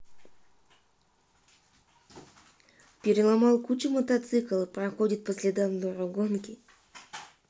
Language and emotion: Russian, neutral